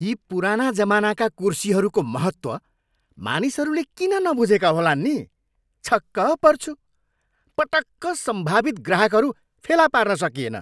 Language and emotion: Nepali, angry